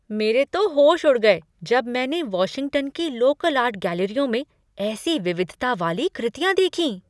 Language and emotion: Hindi, surprised